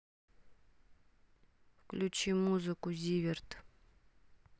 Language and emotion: Russian, neutral